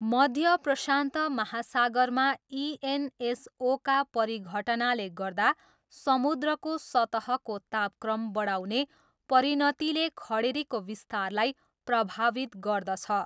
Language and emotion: Nepali, neutral